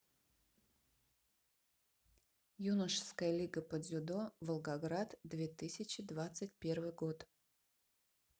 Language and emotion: Russian, neutral